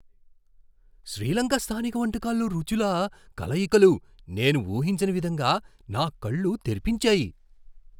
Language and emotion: Telugu, surprised